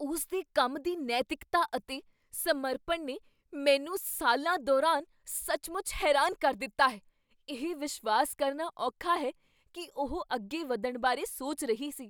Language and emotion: Punjabi, surprised